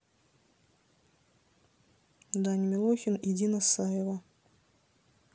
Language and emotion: Russian, neutral